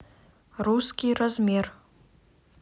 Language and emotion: Russian, neutral